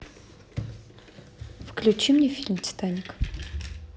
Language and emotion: Russian, neutral